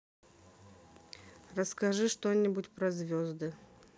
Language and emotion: Russian, neutral